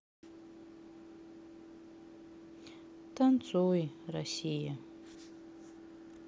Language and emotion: Russian, sad